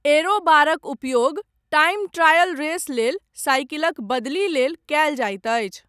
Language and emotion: Maithili, neutral